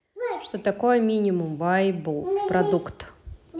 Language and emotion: Russian, neutral